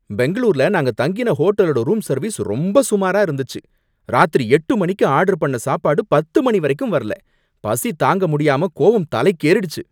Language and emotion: Tamil, angry